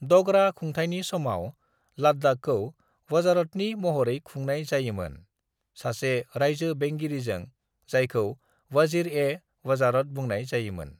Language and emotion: Bodo, neutral